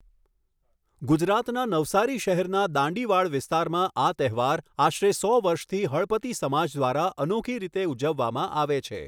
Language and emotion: Gujarati, neutral